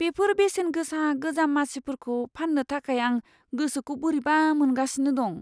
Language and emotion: Bodo, fearful